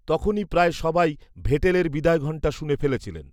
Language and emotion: Bengali, neutral